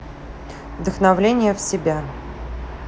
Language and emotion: Russian, neutral